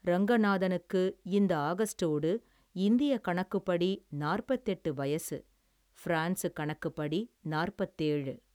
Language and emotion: Tamil, neutral